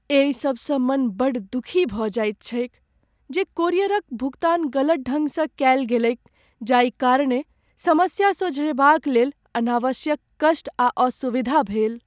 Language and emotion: Maithili, sad